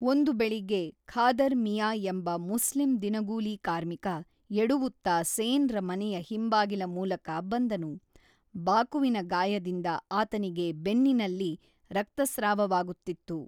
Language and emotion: Kannada, neutral